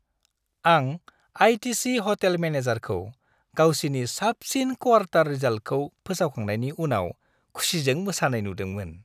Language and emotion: Bodo, happy